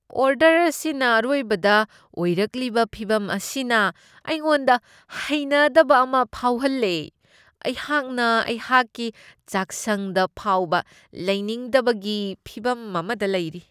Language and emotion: Manipuri, disgusted